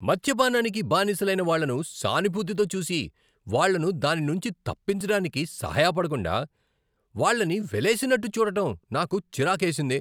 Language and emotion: Telugu, angry